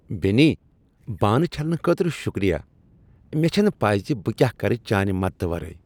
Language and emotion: Kashmiri, happy